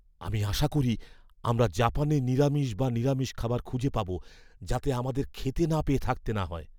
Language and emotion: Bengali, fearful